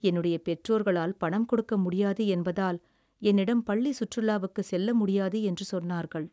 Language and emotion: Tamil, sad